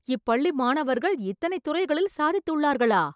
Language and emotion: Tamil, surprised